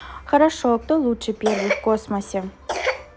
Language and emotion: Russian, neutral